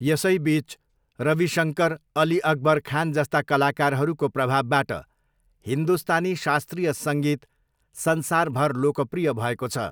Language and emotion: Nepali, neutral